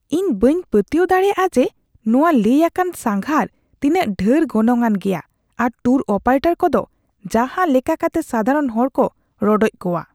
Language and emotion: Santali, disgusted